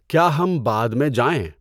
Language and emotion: Urdu, neutral